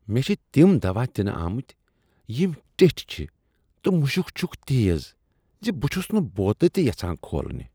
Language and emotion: Kashmiri, disgusted